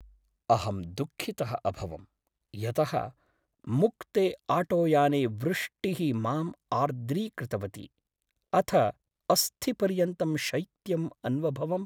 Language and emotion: Sanskrit, sad